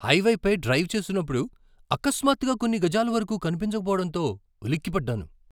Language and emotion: Telugu, surprised